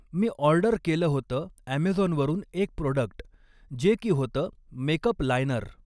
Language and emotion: Marathi, neutral